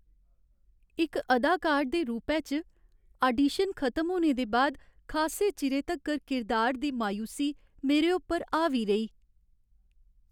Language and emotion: Dogri, sad